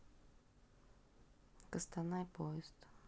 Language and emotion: Russian, neutral